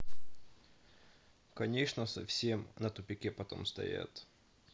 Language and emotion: Russian, neutral